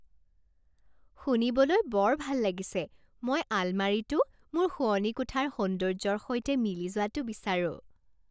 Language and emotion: Assamese, happy